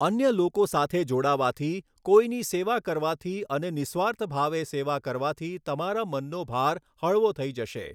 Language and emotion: Gujarati, neutral